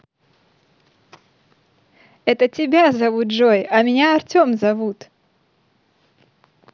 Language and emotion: Russian, positive